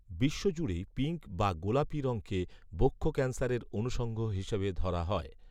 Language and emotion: Bengali, neutral